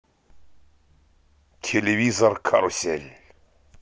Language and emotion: Russian, positive